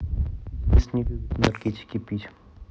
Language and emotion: Russian, neutral